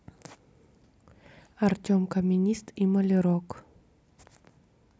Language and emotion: Russian, neutral